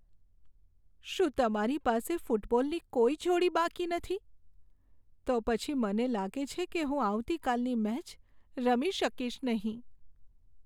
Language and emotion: Gujarati, sad